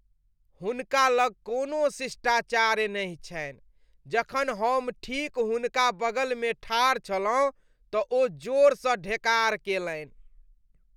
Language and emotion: Maithili, disgusted